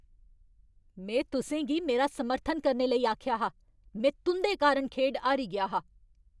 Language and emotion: Dogri, angry